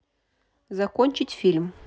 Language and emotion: Russian, neutral